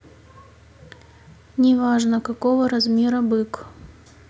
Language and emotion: Russian, neutral